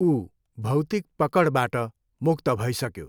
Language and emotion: Nepali, neutral